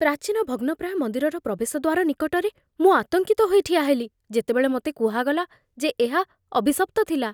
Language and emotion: Odia, fearful